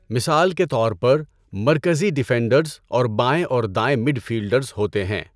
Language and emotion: Urdu, neutral